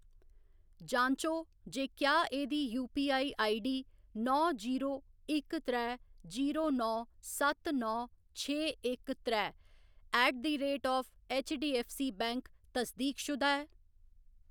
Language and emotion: Dogri, neutral